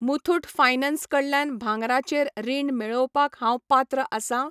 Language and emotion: Goan Konkani, neutral